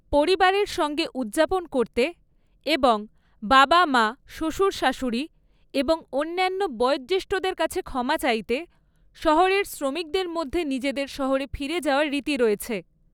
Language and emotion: Bengali, neutral